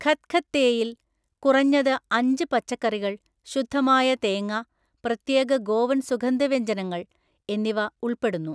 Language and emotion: Malayalam, neutral